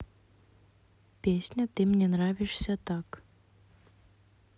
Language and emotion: Russian, neutral